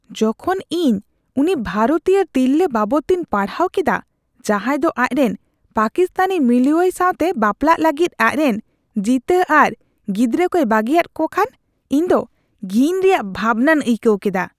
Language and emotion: Santali, disgusted